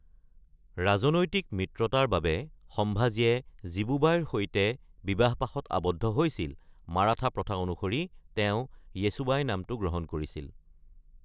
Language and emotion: Assamese, neutral